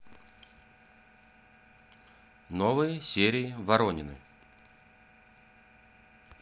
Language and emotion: Russian, neutral